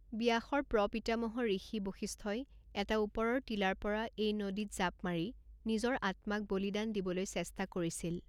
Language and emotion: Assamese, neutral